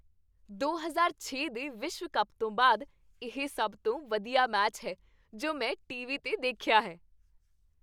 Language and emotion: Punjabi, happy